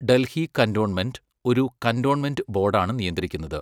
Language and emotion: Malayalam, neutral